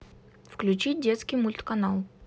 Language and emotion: Russian, neutral